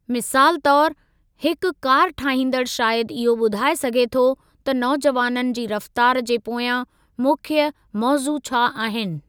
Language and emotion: Sindhi, neutral